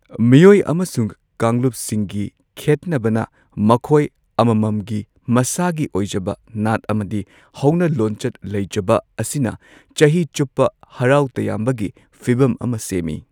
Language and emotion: Manipuri, neutral